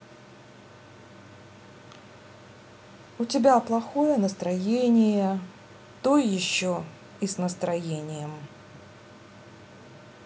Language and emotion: Russian, sad